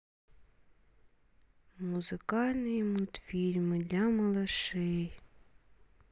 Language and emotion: Russian, sad